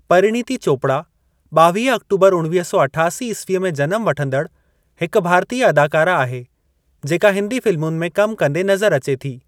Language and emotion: Sindhi, neutral